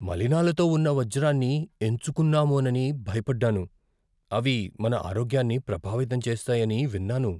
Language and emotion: Telugu, fearful